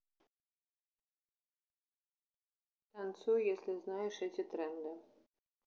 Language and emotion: Russian, neutral